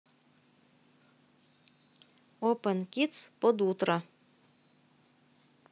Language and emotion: Russian, neutral